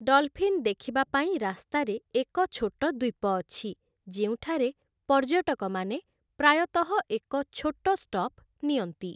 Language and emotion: Odia, neutral